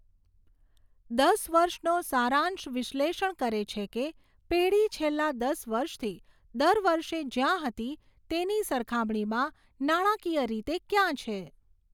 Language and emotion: Gujarati, neutral